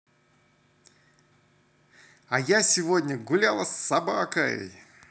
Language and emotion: Russian, positive